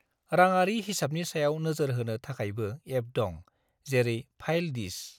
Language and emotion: Bodo, neutral